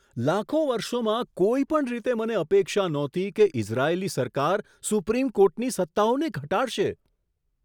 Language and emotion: Gujarati, surprised